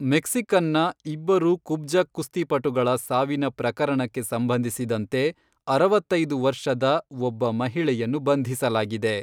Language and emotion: Kannada, neutral